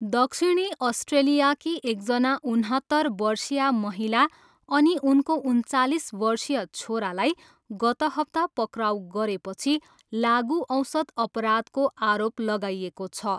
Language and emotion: Nepali, neutral